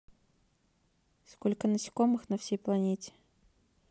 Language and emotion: Russian, neutral